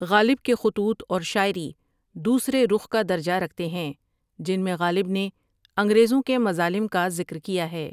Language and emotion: Urdu, neutral